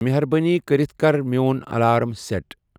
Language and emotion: Kashmiri, neutral